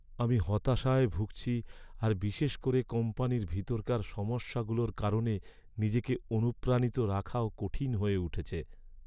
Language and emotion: Bengali, sad